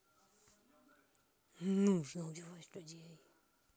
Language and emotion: Russian, angry